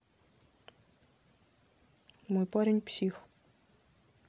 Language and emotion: Russian, neutral